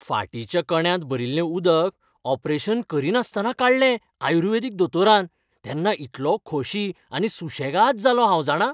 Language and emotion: Goan Konkani, happy